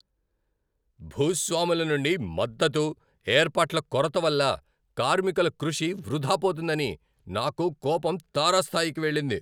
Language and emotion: Telugu, angry